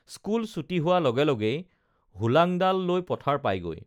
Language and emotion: Assamese, neutral